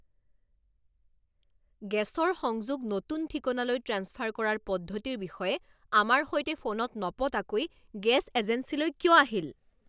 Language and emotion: Assamese, angry